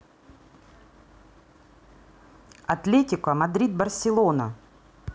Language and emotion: Russian, neutral